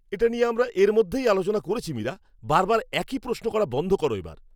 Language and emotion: Bengali, angry